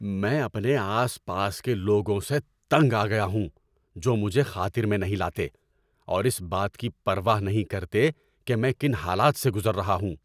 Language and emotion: Urdu, angry